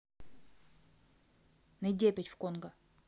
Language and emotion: Russian, neutral